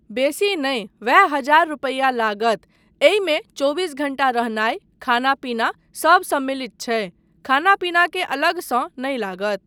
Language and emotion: Maithili, neutral